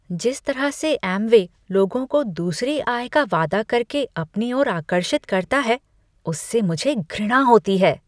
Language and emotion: Hindi, disgusted